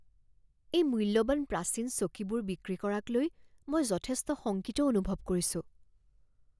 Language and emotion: Assamese, fearful